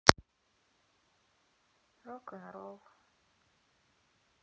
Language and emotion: Russian, sad